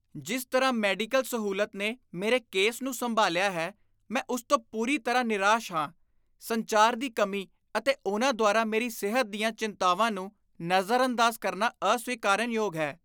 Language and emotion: Punjabi, disgusted